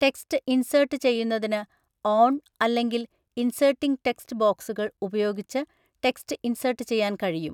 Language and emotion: Malayalam, neutral